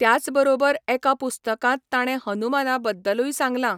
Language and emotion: Goan Konkani, neutral